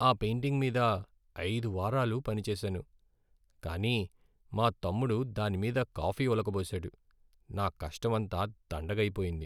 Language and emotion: Telugu, sad